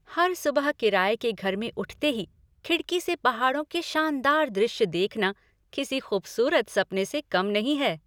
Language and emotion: Hindi, happy